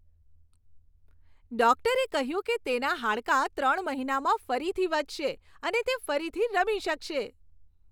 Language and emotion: Gujarati, happy